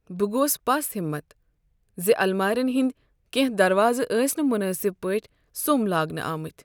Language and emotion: Kashmiri, sad